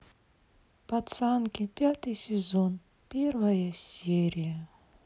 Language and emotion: Russian, sad